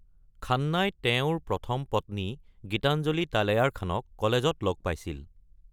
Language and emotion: Assamese, neutral